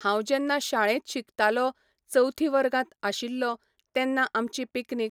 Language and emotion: Goan Konkani, neutral